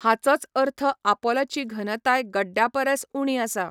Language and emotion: Goan Konkani, neutral